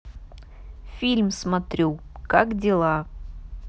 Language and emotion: Russian, neutral